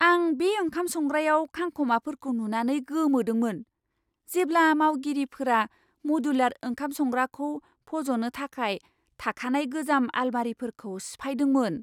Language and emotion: Bodo, surprised